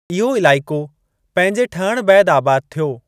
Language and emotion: Sindhi, neutral